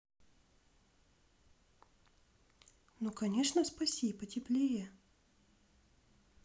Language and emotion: Russian, positive